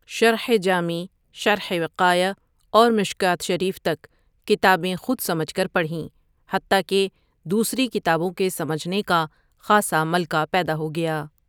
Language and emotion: Urdu, neutral